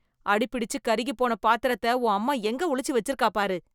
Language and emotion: Tamil, disgusted